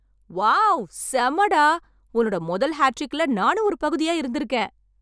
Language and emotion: Tamil, happy